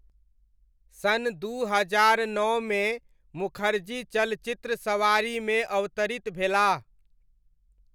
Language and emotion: Maithili, neutral